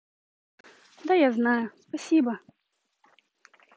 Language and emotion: Russian, neutral